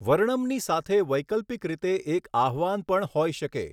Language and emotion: Gujarati, neutral